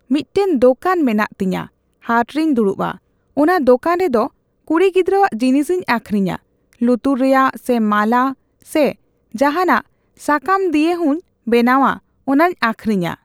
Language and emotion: Santali, neutral